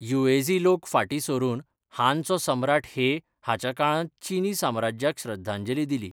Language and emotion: Goan Konkani, neutral